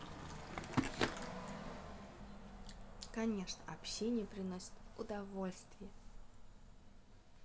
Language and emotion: Russian, positive